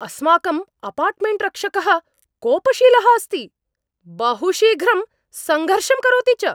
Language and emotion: Sanskrit, angry